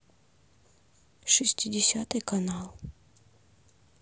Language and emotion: Russian, neutral